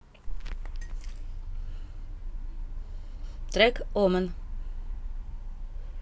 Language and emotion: Russian, neutral